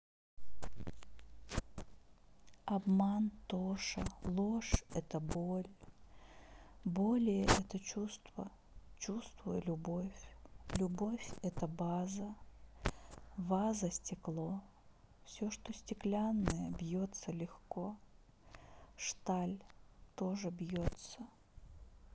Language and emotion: Russian, sad